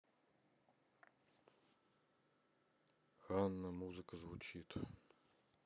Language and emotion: Russian, sad